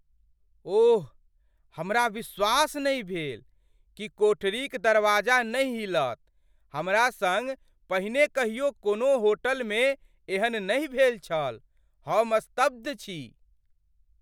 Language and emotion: Maithili, surprised